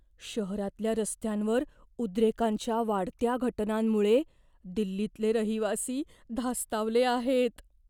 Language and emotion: Marathi, fearful